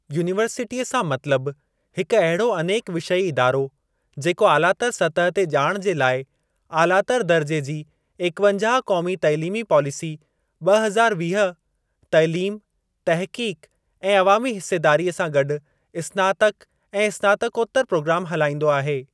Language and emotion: Sindhi, neutral